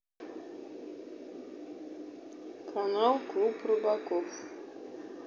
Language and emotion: Russian, neutral